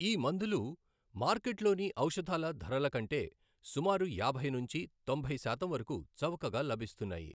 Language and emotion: Telugu, neutral